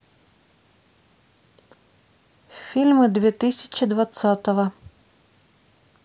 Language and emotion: Russian, neutral